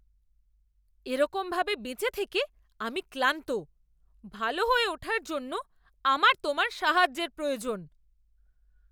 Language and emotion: Bengali, angry